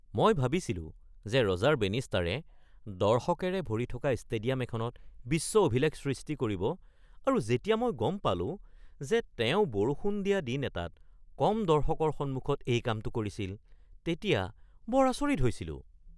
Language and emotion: Assamese, surprised